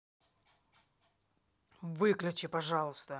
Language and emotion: Russian, angry